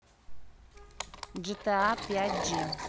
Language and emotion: Russian, neutral